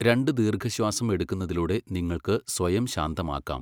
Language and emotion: Malayalam, neutral